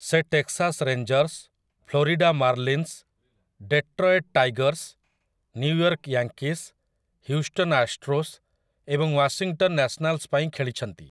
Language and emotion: Odia, neutral